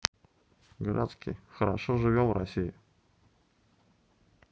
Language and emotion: Russian, neutral